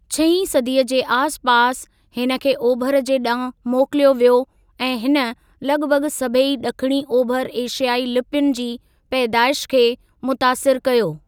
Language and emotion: Sindhi, neutral